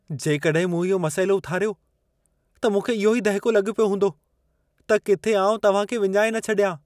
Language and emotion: Sindhi, fearful